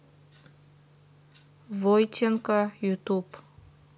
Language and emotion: Russian, neutral